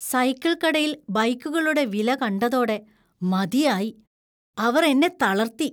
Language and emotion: Malayalam, disgusted